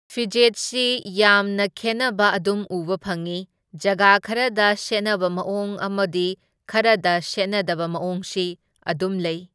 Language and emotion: Manipuri, neutral